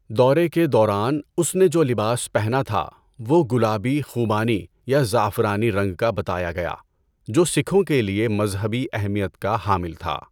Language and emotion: Urdu, neutral